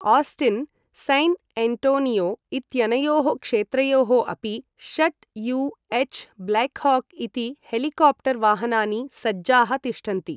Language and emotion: Sanskrit, neutral